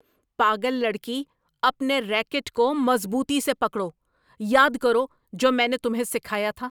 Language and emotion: Urdu, angry